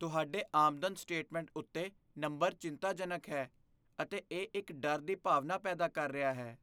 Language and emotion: Punjabi, fearful